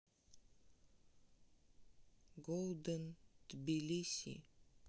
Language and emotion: Russian, neutral